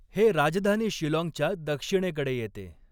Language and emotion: Marathi, neutral